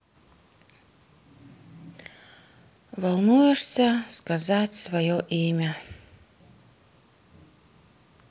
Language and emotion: Russian, sad